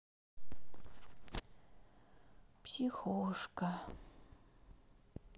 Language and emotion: Russian, sad